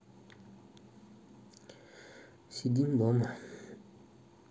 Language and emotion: Russian, sad